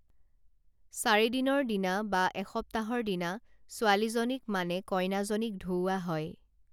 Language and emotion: Assamese, neutral